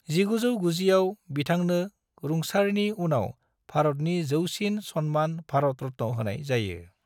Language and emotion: Bodo, neutral